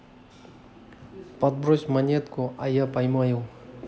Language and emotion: Russian, neutral